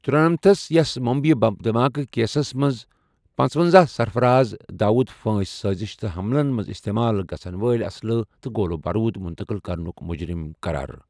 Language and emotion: Kashmiri, neutral